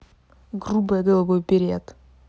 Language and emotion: Russian, angry